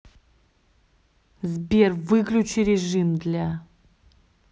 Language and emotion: Russian, angry